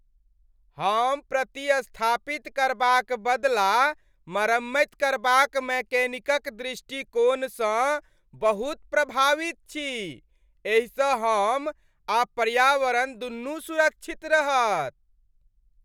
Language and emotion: Maithili, happy